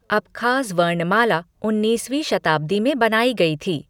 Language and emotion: Hindi, neutral